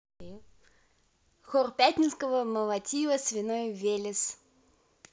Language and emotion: Russian, neutral